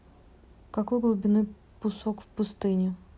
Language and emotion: Russian, neutral